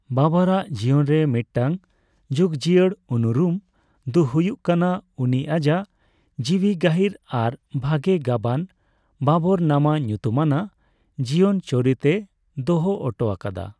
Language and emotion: Santali, neutral